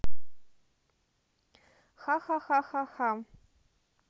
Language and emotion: Russian, neutral